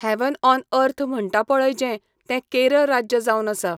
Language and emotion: Goan Konkani, neutral